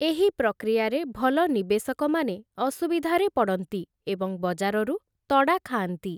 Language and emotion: Odia, neutral